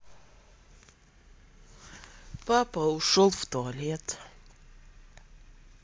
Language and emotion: Russian, sad